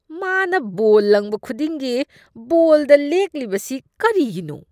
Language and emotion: Manipuri, disgusted